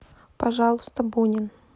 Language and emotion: Russian, neutral